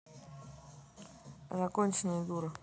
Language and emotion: Russian, neutral